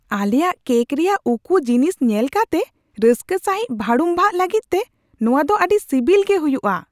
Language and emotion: Santali, surprised